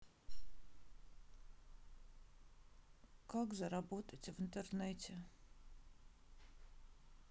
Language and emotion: Russian, sad